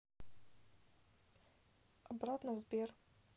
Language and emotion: Russian, neutral